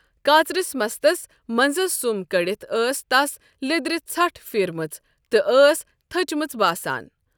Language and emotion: Kashmiri, neutral